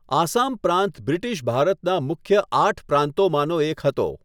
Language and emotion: Gujarati, neutral